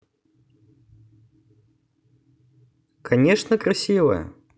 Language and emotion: Russian, positive